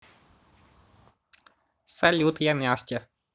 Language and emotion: Russian, positive